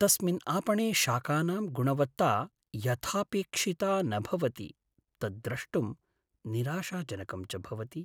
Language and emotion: Sanskrit, sad